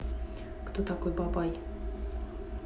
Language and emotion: Russian, neutral